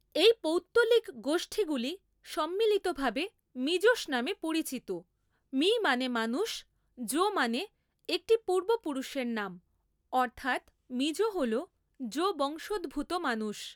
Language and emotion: Bengali, neutral